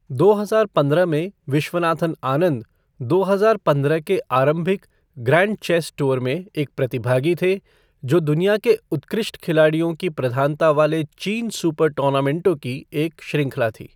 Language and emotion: Hindi, neutral